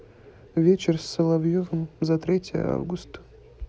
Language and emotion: Russian, sad